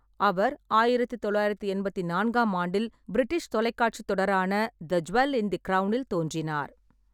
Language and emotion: Tamil, neutral